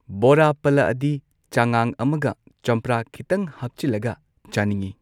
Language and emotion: Manipuri, neutral